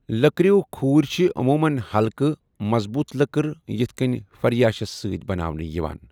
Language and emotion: Kashmiri, neutral